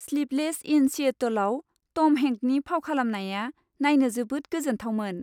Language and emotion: Bodo, happy